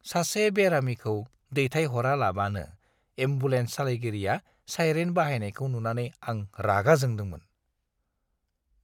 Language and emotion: Bodo, disgusted